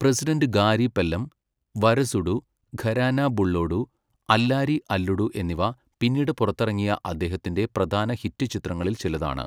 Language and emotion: Malayalam, neutral